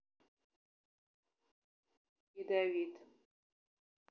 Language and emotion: Russian, neutral